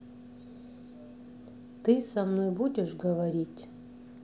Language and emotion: Russian, neutral